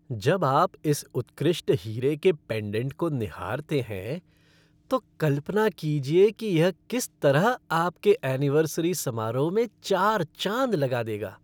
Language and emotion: Hindi, happy